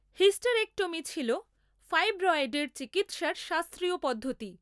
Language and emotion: Bengali, neutral